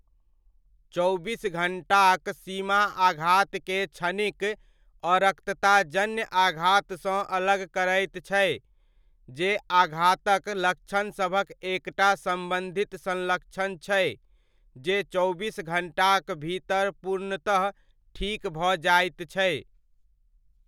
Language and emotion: Maithili, neutral